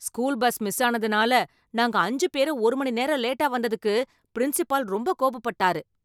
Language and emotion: Tamil, angry